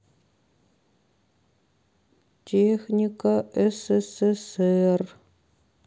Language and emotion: Russian, sad